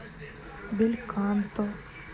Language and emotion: Russian, sad